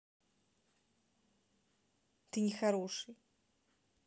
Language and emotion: Russian, neutral